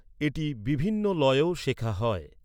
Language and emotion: Bengali, neutral